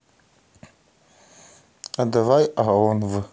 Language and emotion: Russian, neutral